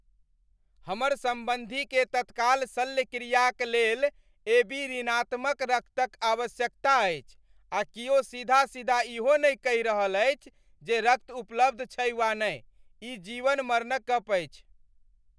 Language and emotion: Maithili, angry